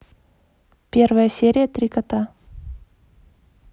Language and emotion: Russian, neutral